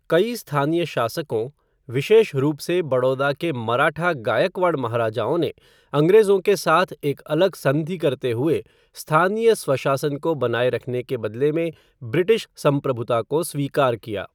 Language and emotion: Hindi, neutral